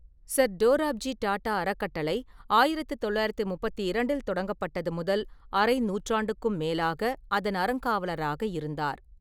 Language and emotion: Tamil, neutral